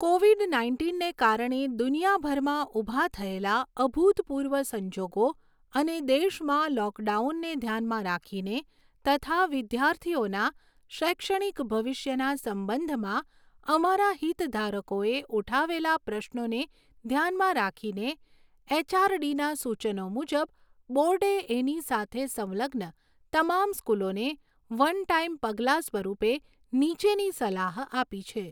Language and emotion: Gujarati, neutral